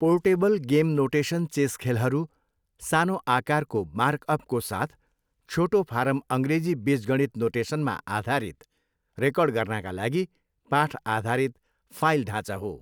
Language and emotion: Nepali, neutral